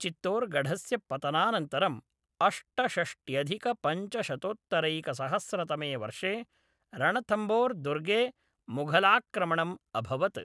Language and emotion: Sanskrit, neutral